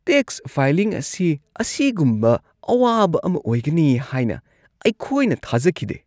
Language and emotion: Manipuri, disgusted